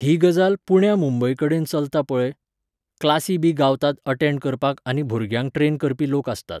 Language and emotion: Goan Konkani, neutral